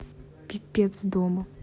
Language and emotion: Russian, angry